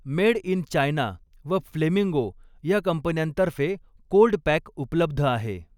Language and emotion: Marathi, neutral